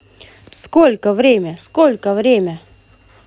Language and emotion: Russian, positive